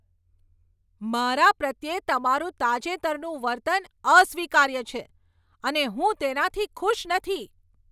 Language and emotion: Gujarati, angry